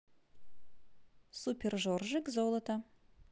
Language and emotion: Russian, positive